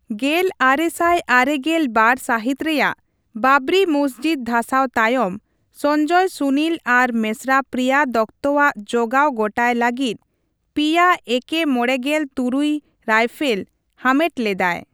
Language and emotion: Santali, neutral